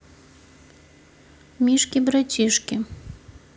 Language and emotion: Russian, neutral